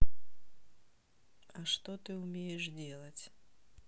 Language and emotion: Russian, neutral